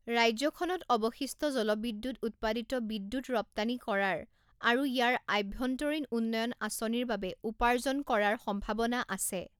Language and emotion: Assamese, neutral